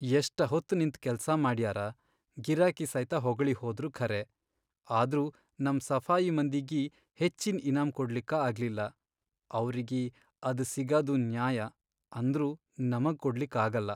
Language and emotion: Kannada, sad